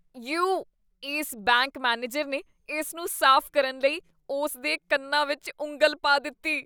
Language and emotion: Punjabi, disgusted